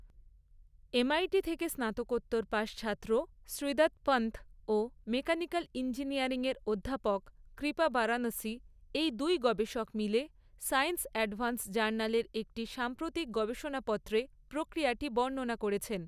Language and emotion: Bengali, neutral